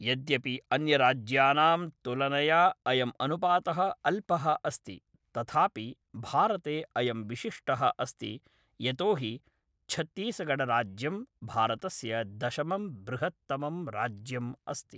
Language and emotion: Sanskrit, neutral